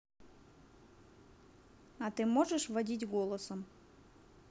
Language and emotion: Russian, neutral